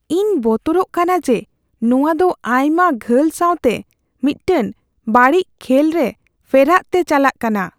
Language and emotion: Santali, fearful